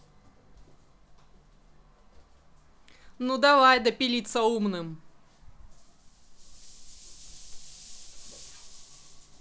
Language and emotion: Russian, angry